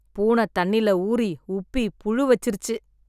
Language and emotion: Tamil, disgusted